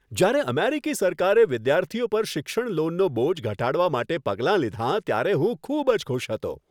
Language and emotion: Gujarati, happy